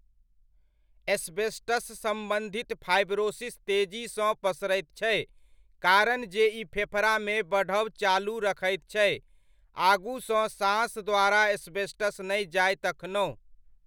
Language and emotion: Maithili, neutral